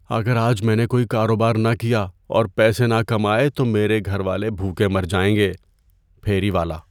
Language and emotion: Urdu, fearful